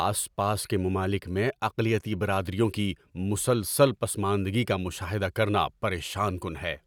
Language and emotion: Urdu, angry